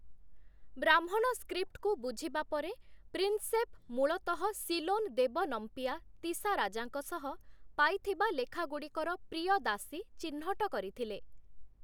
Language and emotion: Odia, neutral